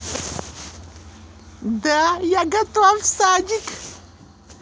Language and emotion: Russian, positive